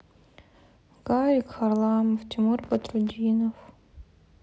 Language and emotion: Russian, sad